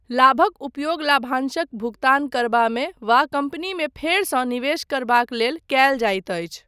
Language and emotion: Maithili, neutral